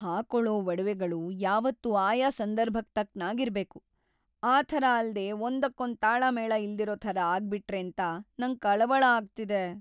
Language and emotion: Kannada, fearful